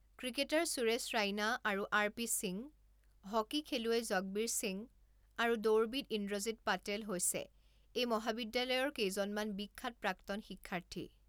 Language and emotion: Assamese, neutral